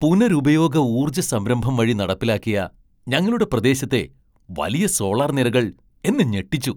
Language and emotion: Malayalam, surprised